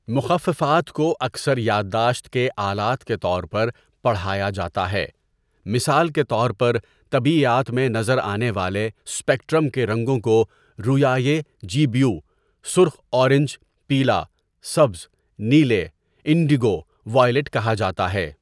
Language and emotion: Urdu, neutral